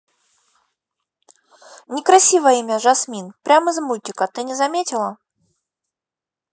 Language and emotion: Russian, neutral